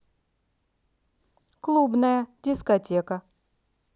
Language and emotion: Russian, positive